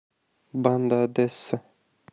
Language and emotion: Russian, neutral